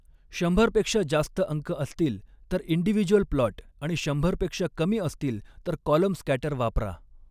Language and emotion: Marathi, neutral